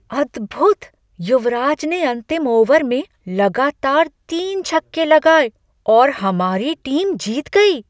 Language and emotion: Hindi, surprised